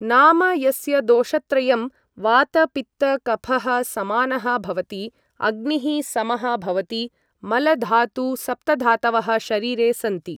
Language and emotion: Sanskrit, neutral